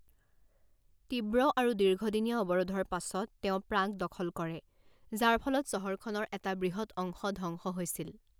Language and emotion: Assamese, neutral